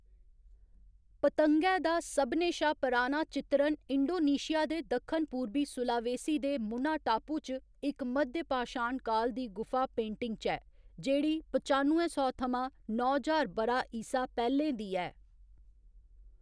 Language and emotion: Dogri, neutral